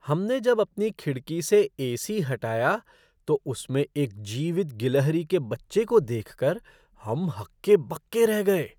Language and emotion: Hindi, surprised